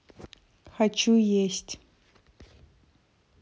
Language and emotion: Russian, neutral